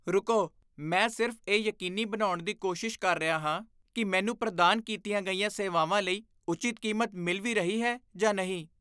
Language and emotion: Punjabi, disgusted